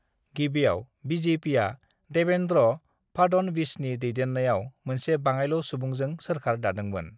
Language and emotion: Bodo, neutral